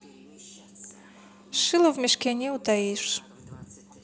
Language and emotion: Russian, neutral